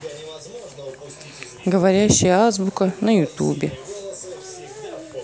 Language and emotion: Russian, neutral